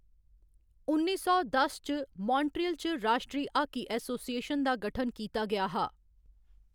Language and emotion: Dogri, neutral